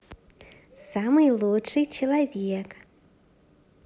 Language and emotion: Russian, positive